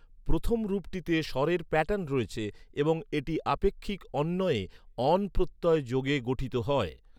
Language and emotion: Bengali, neutral